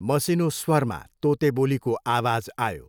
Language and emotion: Nepali, neutral